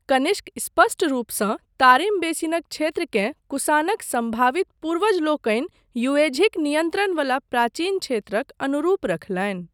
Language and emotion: Maithili, neutral